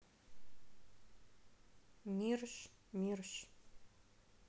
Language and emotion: Russian, neutral